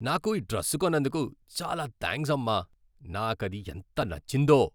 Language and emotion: Telugu, happy